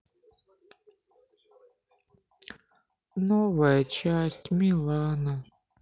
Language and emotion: Russian, sad